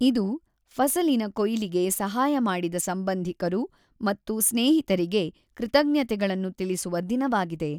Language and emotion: Kannada, neutral